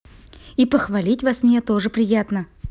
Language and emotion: Russian, positive